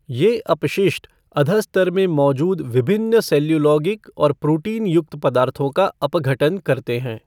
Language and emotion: Hindi, neutral